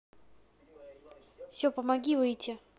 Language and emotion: Russian, neutral